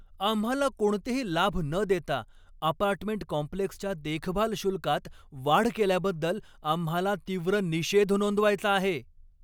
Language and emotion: Marathi, angry